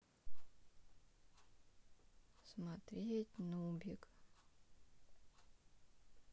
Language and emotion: Russian, sad